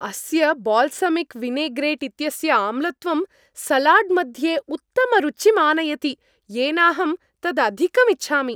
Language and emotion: Sanskrit, happy